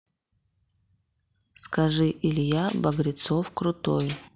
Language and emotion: Russian, neutral